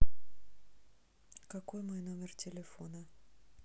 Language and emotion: Russian, neutral